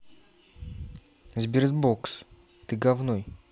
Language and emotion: Russian, neutral